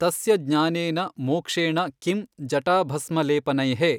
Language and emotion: Kannada, neutral